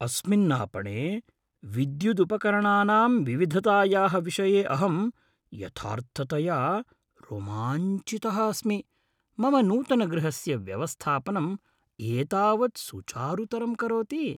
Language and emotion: Sanskrit, happy